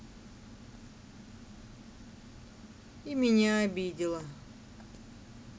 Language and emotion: Russian, sad